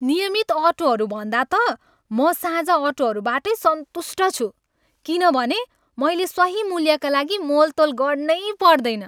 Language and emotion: Nepali, happy